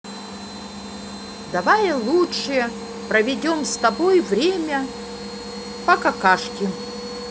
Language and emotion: Russian, positive